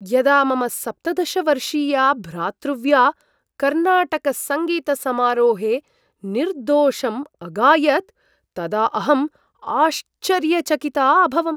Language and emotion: Sanskrit, surprised